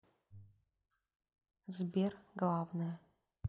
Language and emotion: Russian, neutral